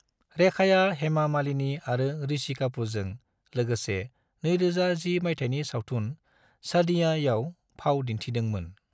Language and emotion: Bodo, neutral